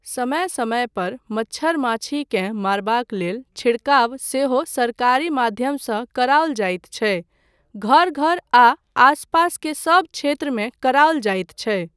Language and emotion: Maithili, neutral